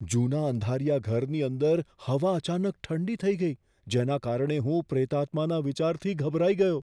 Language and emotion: Gujarati, fearful